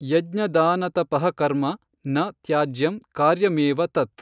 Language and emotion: Kannada, neutral